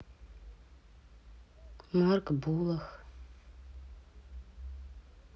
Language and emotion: Russian, sad